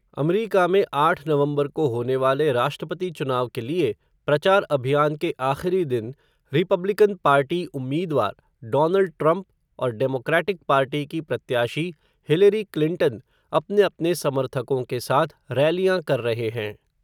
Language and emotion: Hindi, neutral